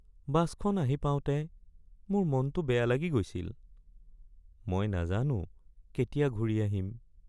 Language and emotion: Assamese, sad